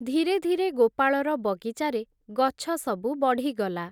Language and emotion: Odia, neutral